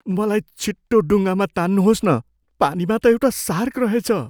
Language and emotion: Nepali, fearful